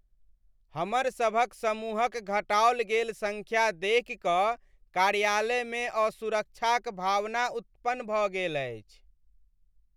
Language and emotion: Maithili, sad